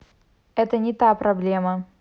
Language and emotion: Russian, neutral